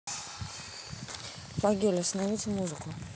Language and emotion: Russian, neutral